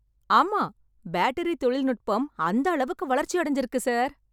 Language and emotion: Tamil, happy